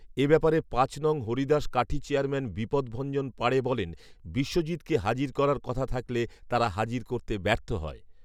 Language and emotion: Bengali, neutral